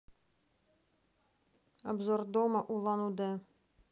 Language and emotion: Russian, neutral